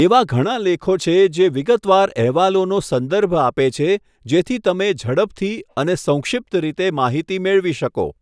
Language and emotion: Gujarati, neutral